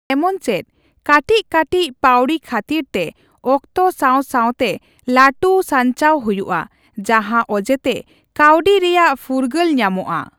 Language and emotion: Santali, neutral